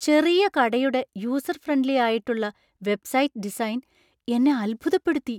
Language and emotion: Malayalam, surprised